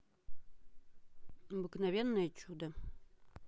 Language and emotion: Russian, neutral